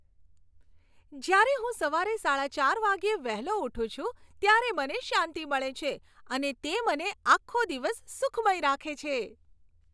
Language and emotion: Gujarati, happy